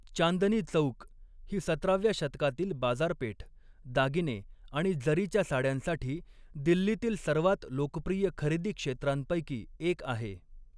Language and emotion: Marathi, neutral